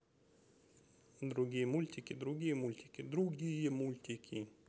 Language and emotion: Russian, neutral